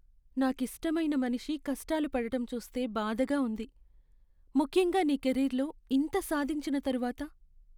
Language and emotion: Telugu, sad